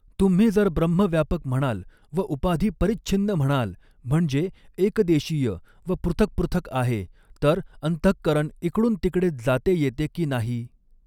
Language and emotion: Marathi, neutral